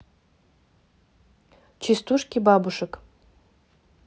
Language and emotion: Russian, neutral